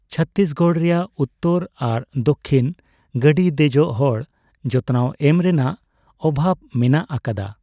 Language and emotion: Santali, neutral